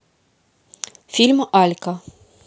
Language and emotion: Russian, neutral